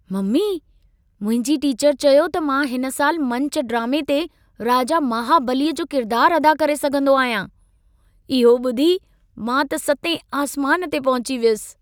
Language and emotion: Sindhi, happy